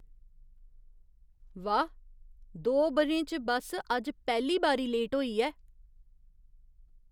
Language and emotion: Dogri, surprised